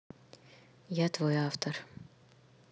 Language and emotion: Russian, neutral